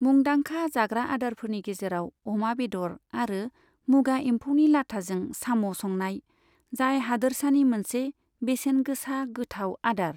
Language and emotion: Bodo, neutral